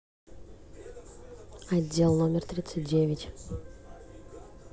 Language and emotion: Russian, neutral